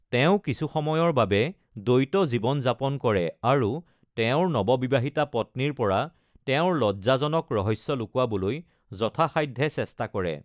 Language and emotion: Assamese, neutral